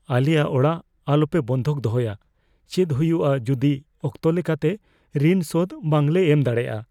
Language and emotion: Santali, fearful